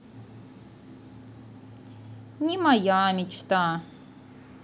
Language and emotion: Russian, sad